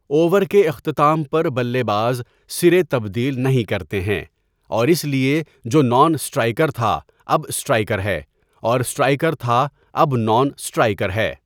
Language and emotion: Urdu, neutral